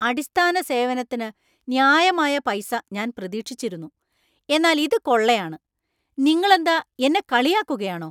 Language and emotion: Malayalam, angry